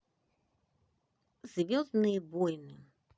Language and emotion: Russian, neutral